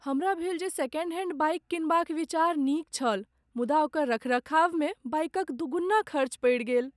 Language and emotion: Maithili, sad